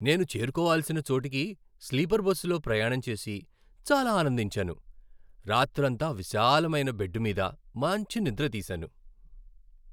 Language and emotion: Telugu, happy